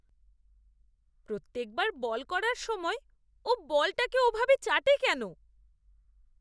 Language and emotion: Bengali, disgusted